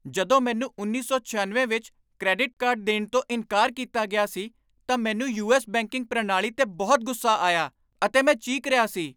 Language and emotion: Punjabi, angry